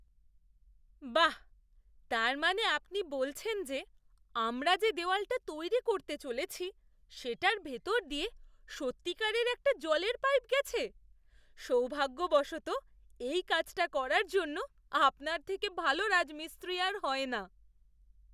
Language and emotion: Bengali, surprised